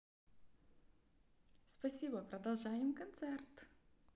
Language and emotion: Russian, positive